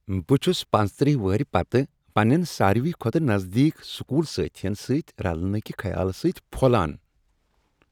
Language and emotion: Kashmiri, happy